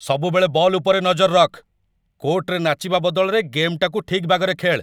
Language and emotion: Odia, angry